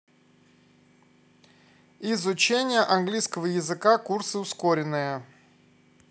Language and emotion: Russian, neutral